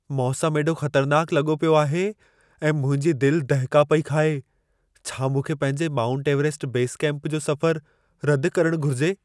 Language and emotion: Sindhi, fearful